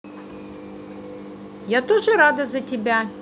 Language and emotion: Russian, positive